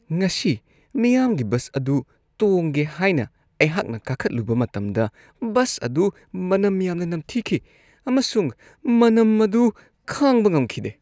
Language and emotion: Manipuri, disgusted